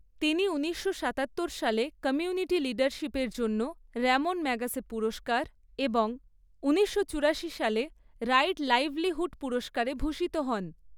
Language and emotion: Bengali, neutral